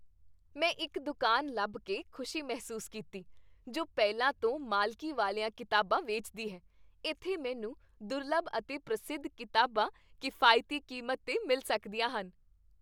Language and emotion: Punjabi, happy